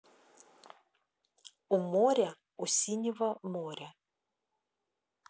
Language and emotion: Russian, neutral